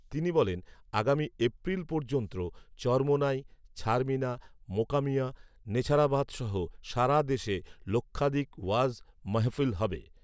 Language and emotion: Bengali, neutral